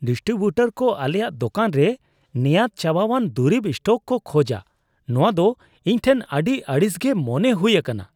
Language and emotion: Santali, disgusted